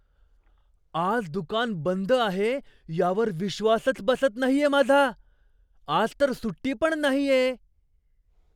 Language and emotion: Marathi, surprised